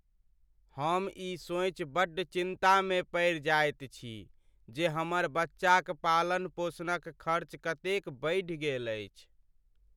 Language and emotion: Maithili, sad